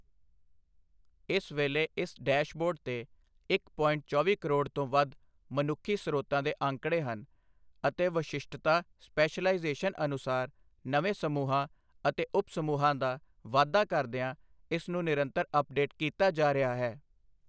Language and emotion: Punjabi, neutral